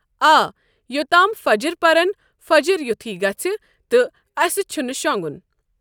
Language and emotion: Kashmiri, neutral